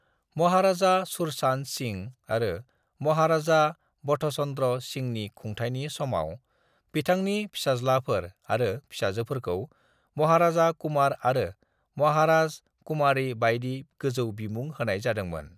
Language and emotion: Bodo, neutral